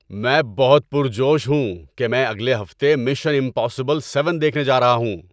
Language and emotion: Urdu, happy